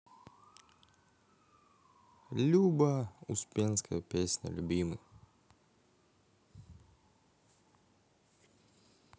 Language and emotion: Russian, positive